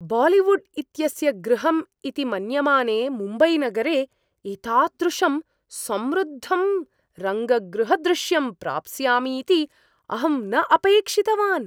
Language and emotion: Sanskrit, surprised